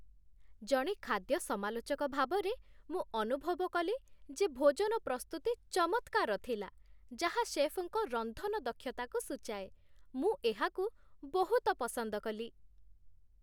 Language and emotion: Odia, happy